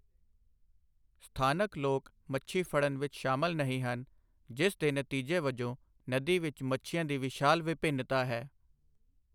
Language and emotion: Punjabi, neutral